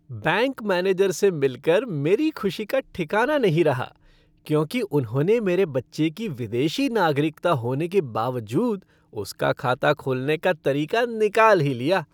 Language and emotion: Hindi, happy